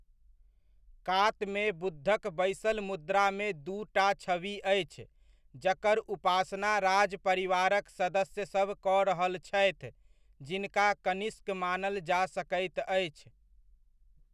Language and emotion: Maithili, neutral